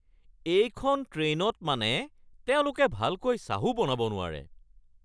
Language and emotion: Assamese, angry